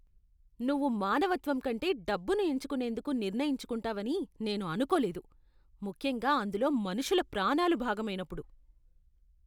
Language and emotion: Telugu, disgusted